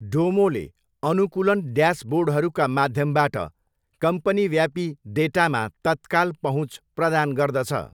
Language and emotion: Nepali, neutral